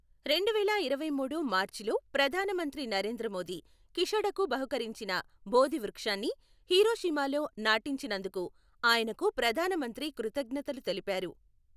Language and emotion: Telugu, neutral